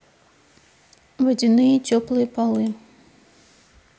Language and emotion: Russian, neutral